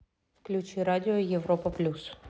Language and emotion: Russian, neutral